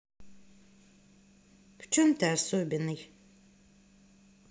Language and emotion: Russian, neutral